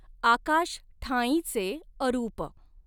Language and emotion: Marathi, neutral